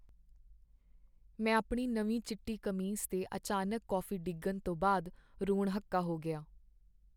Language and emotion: Punjabi, sad